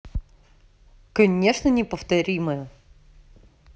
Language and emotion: Russian, neutral